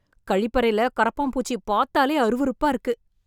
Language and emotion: Tamil, disgusted